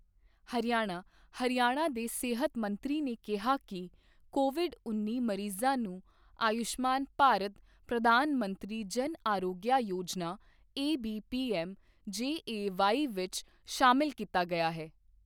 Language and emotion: Punjabi, neutral